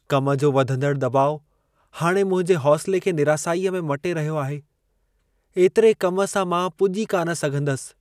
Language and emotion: Sindhi, sad